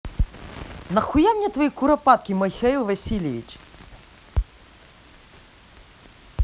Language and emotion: Russian, angry